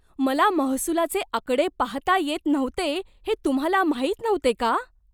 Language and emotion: Marathi, surprised